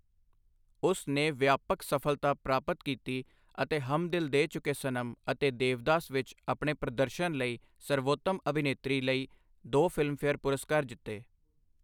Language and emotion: Punjabi, neutral